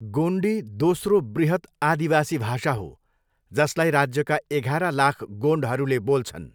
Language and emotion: Nepali, neutral